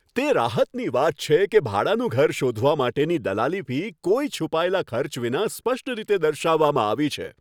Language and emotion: Gujarati, happy